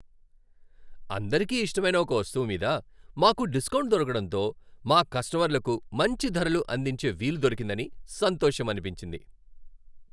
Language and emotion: Telugu, happy